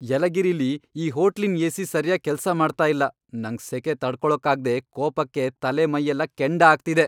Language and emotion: Kannada, angry